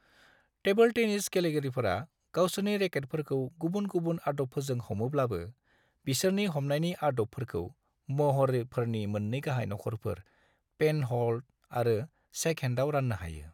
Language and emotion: Bodo, neutral